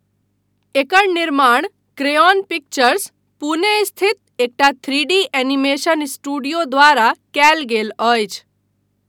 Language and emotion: Maithili, neutral